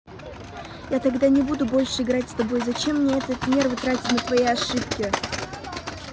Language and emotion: Russian, angry